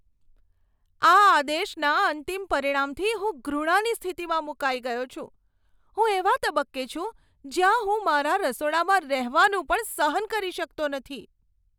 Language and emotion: Gujarati, disgusted